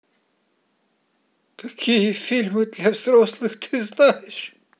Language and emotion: Russian, sad